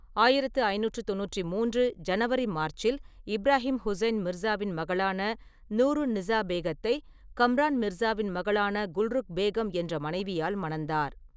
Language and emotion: Tamil, neutral